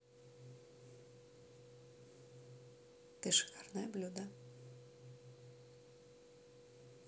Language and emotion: Russian, neutral